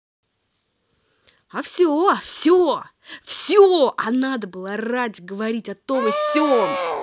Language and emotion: Russian, angry